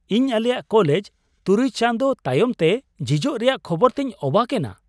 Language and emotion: Santali, surprised